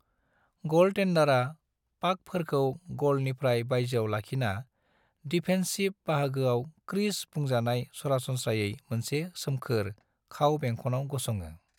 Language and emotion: Bodo, neutral